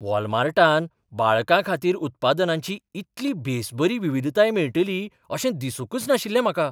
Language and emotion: Goan Konkani, surprised